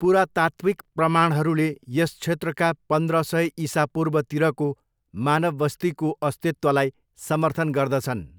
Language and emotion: Nepali, neutral